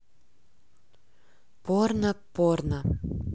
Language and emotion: Russian, neutral